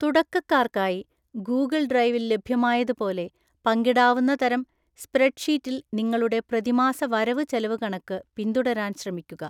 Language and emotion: Malayalam, neutral